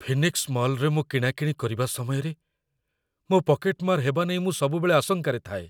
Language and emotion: Odia, fearful